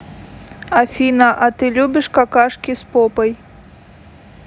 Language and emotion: Russian, neutral